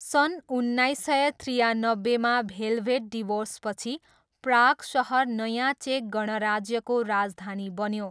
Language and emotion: Nepali, neutral